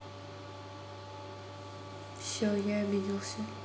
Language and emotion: Russian, neutral